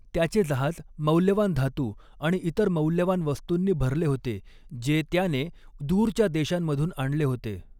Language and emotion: Marathi, neutral